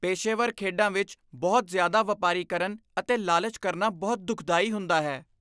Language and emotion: Punjabi, disgusted